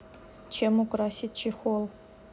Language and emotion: Russian, neutral